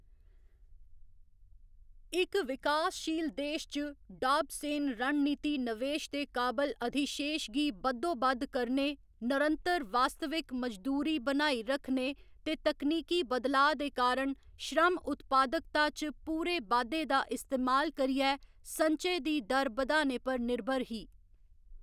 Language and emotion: Dogri, neutral